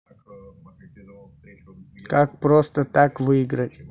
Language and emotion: Russian, neutral